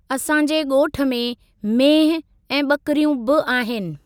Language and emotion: Sindhi, neutral